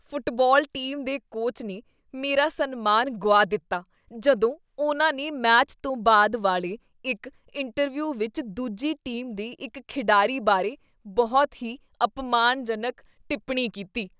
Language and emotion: Punjabi, disgusted